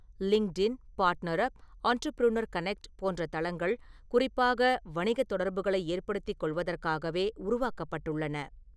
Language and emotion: Tamil, neutral